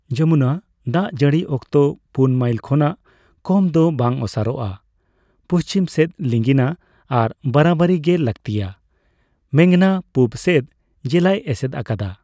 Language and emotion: Santali, neutral